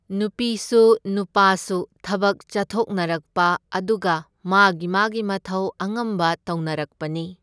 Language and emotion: Manipuri, neutral